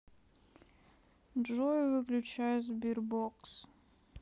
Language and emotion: Russian, sad